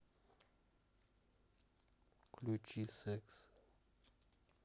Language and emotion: Russian, neutral